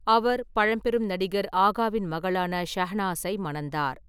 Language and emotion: Tamil, neutral